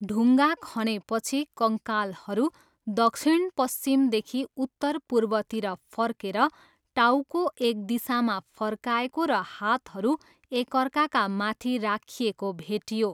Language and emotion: Nepali, neutral